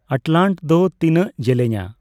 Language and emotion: Santali, neutral